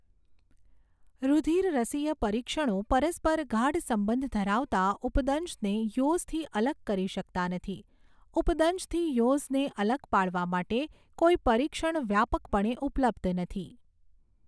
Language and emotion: Gujarati, neutral